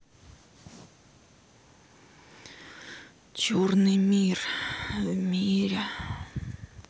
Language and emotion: Russian, sad